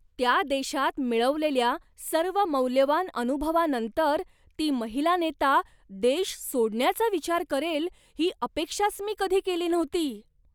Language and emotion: Marathi, surprised